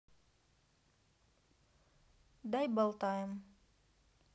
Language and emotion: Russian, neutral